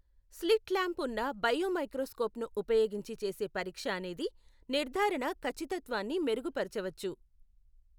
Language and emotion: Telugu, neutral